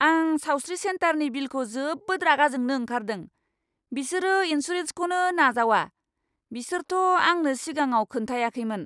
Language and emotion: Bodo, angry